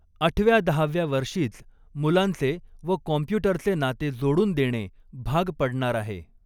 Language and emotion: Marathi, neutral